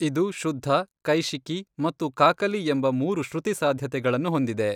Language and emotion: Kannada, neutral